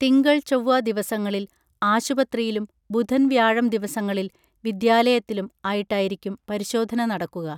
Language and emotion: Malayalam, neutral